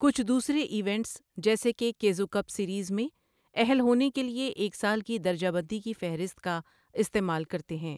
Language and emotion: Urdu, neutral